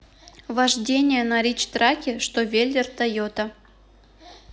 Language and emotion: Russian, neutral